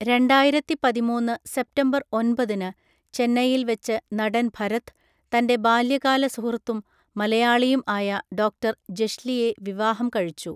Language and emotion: Malayalam, neutral